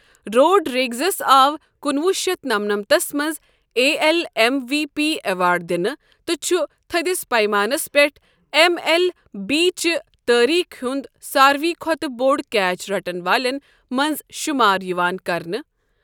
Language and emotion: Kashmiri, neutral